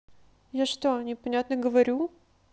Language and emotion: Russian, neutral